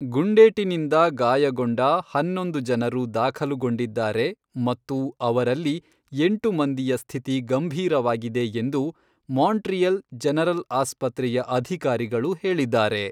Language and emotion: Kannada, neutral